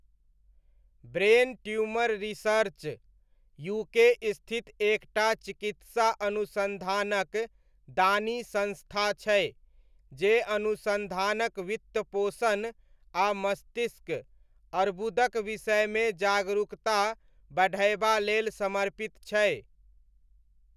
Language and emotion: Maithili, neutral